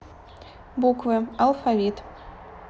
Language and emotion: Russian, neutral